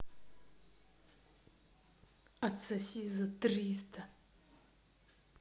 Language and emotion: Russian, angry